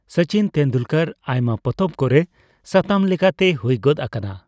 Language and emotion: Santali, neutral